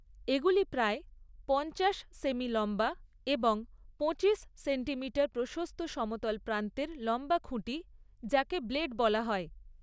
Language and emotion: Bengali, neutral